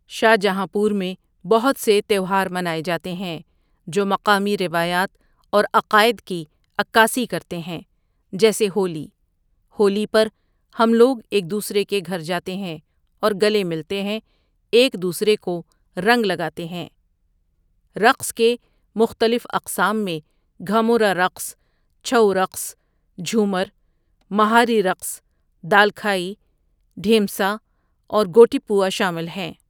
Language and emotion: Urdu, neutral